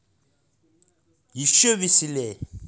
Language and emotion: Russian, angry